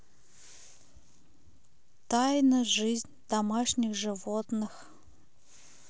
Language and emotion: Russian, neutral